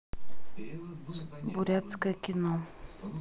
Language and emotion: Russian, neutral